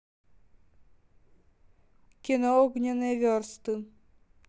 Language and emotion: Russian, neutral